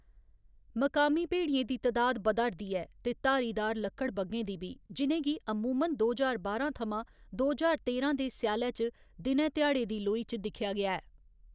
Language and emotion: Dogri, neutral